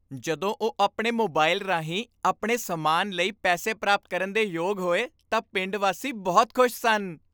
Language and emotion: Punjabi, happy